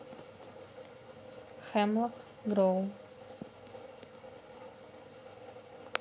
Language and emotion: Russian, neutral